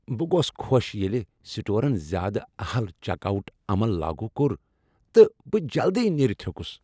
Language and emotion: Kashmiri, happy